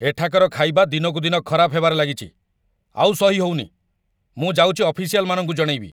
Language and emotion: Odia, angry